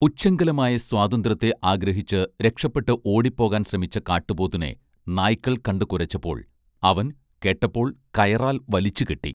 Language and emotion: Malayalam, neutral